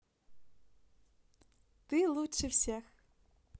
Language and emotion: Russian, positive